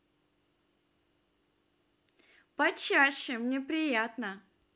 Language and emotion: Russian, positive